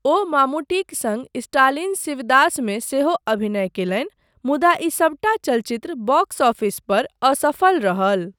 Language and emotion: Maithili, neutral